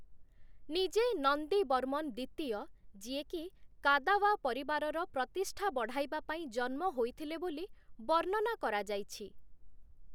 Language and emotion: Odia, neutral